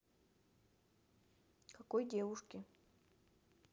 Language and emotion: Russian, neutral